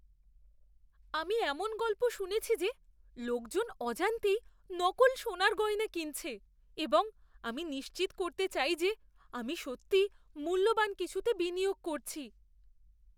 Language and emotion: Bengali, fearful